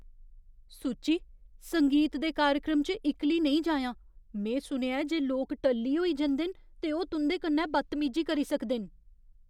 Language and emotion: Dogri, fearful